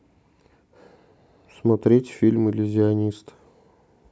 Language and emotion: Russian, neutral